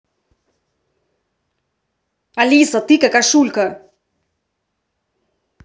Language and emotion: Russian, angry